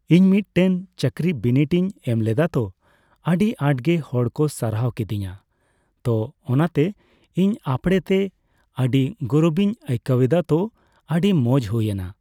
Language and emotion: Santali, neutral